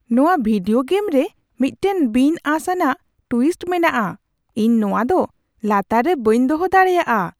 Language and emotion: Santali, surprised